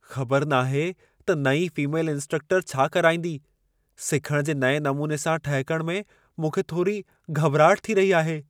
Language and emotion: Sindhi, fearful